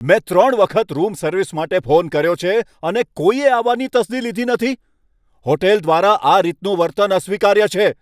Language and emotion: Gujarati, angry